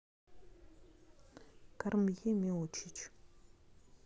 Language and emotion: Russian, neutral